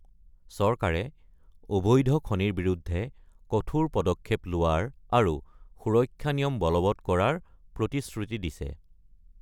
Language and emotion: Assamese, neutral